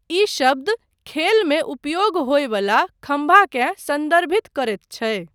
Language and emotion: Maithili, neutral